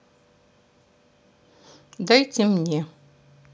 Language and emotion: Russian, neutral